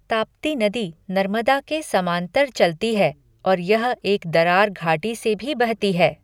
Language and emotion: Hindi, neutral